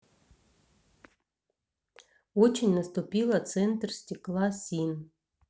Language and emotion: Russian, neutral